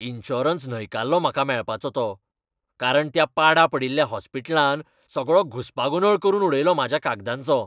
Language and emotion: Goan Konkani, angry